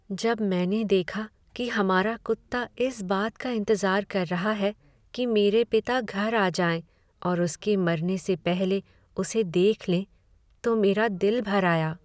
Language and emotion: Hindi, sad